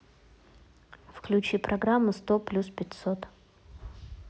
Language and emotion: Russian, neutral